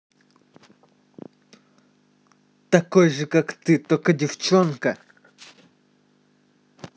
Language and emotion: Russian, angry